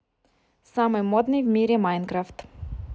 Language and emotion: Russian, neutral